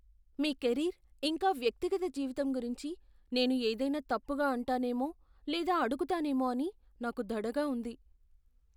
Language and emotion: Telugu, fearful